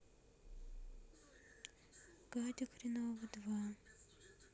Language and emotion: Russian, neutral